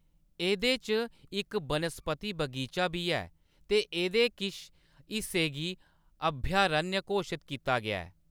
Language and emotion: Dogri, neutral